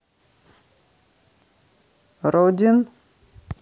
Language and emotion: Russian, neutral